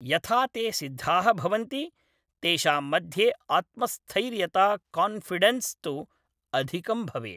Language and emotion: Sanskrit, neutral